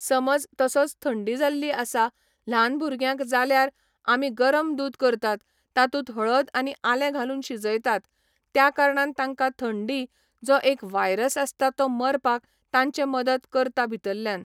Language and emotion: Goan Konkani, neutral